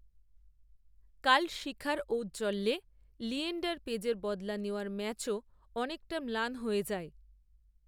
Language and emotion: Bengali, neutral